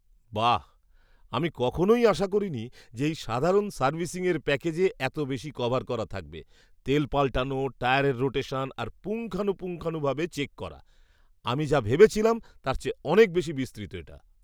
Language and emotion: Bengali, surprised